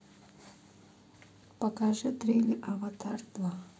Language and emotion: Russian, neutral